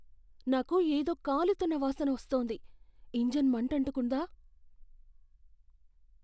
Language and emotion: Telugu, fearful